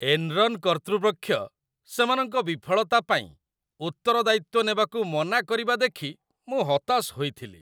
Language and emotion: Odia, disgusted